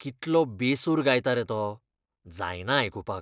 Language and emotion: Goan Konkani, disgusted